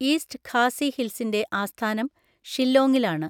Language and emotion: Malayalam, neutral